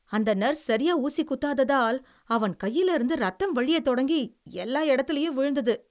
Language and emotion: Tamil, disgusted